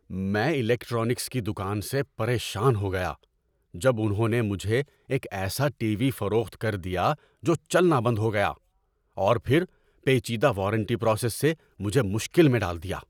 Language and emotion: Urdu, angry